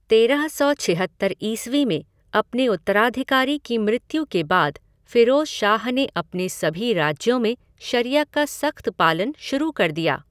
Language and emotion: Hindi, neutral